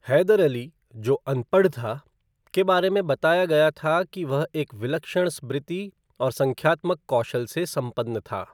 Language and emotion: Hindi, neutral